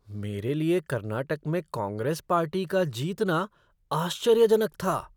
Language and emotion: Hindi, surprised